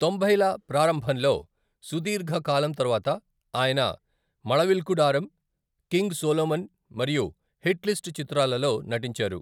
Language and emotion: Telugu, neutral